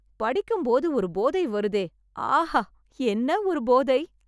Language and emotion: Tamil, happy